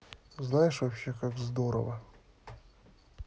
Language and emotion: Russian, neutral